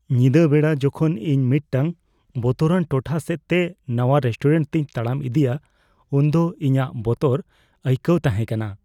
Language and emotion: Santali, fearful